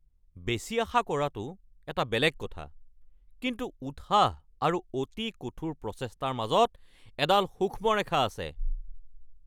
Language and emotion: Assamese, angry